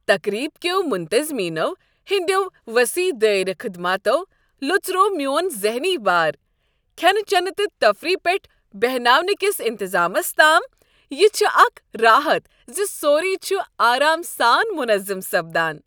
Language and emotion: Kashmiri, happy